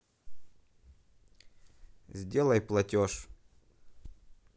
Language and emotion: Russian, neutral